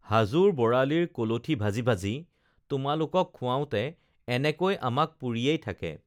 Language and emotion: Assamese, neutral